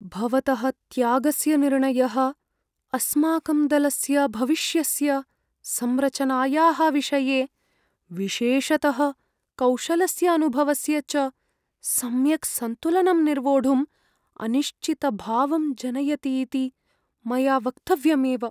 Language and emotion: Sanskrit, fearful